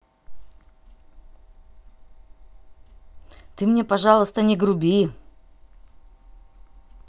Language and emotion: Russian, angry